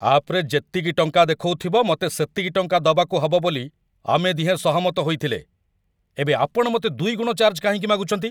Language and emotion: Odia, angry